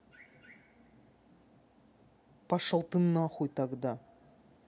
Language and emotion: Russian, angry